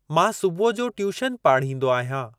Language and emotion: Sindhi, neutral